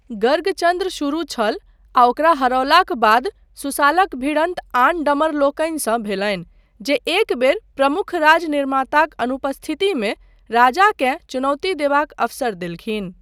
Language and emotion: Maithili, neutral